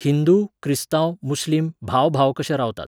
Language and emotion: Goan Konkani, neutral